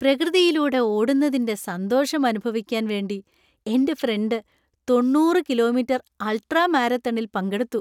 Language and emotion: Malayalam, happy